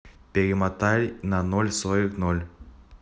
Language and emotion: Russian, neutral